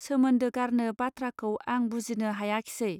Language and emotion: Bodo, neutral